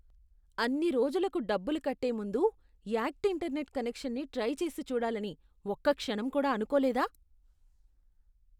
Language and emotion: Telugu, disgusted